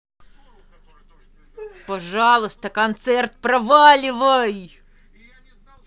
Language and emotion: Russian, angry